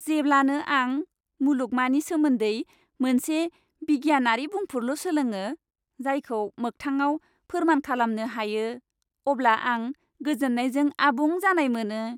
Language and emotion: Bodo, happy